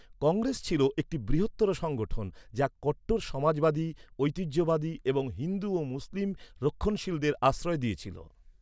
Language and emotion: Bengali, neutral